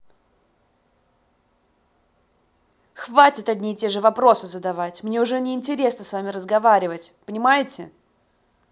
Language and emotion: Russian, angry